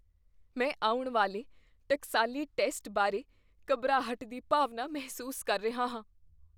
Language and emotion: Punjabi, fearful